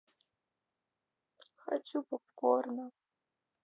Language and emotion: Russian, neutral